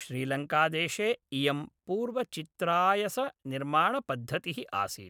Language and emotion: Sanskrit, neutral